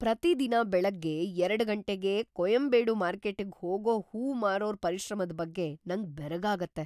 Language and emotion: Kannada, surprised